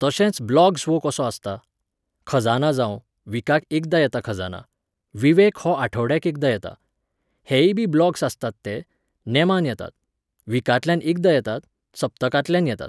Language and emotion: Goan Konkani, neutral